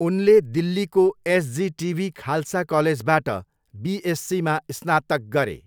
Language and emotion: Nepali, neutral